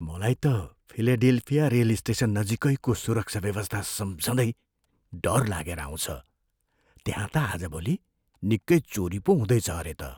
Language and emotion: Nepali, fearful